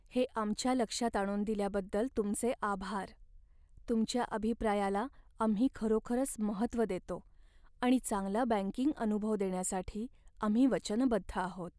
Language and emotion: Marathi, sad